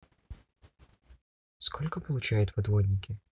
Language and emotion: Russian, neutral